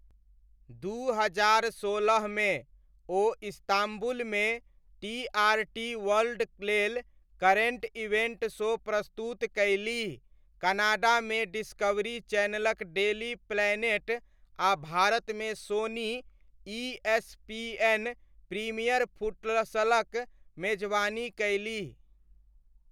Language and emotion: Maithili, neutral